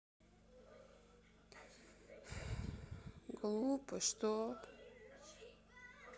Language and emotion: Russian, sad